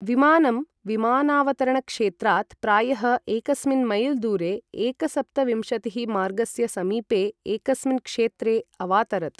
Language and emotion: Sanskrit, neutral